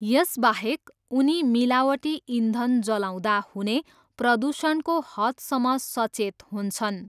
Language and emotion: Nepali, neutral